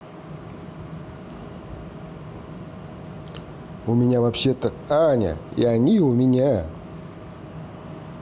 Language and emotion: Russian, positive